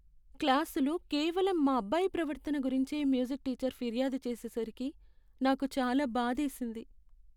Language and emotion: Telugu, sad